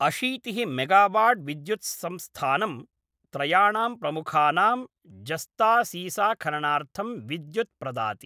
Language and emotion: Sanskrit, neutral